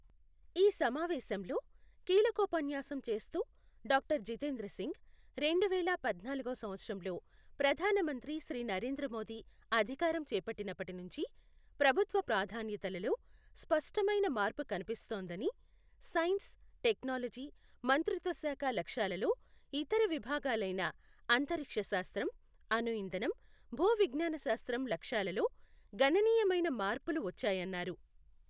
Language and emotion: Telugu, neutral